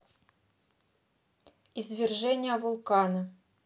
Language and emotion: Russian, neutral